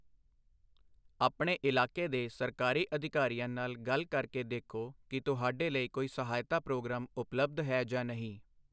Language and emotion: Punjabi, neutral